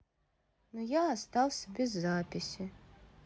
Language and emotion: Russian, sad